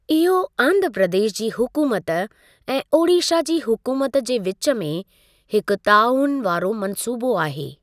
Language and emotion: Sindhi, neutral